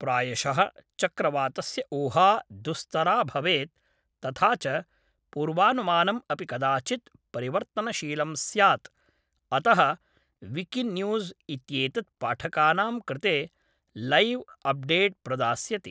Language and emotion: Sanskrit, neutral